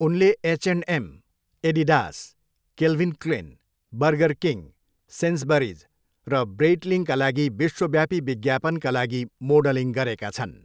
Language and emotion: Nepali, neutral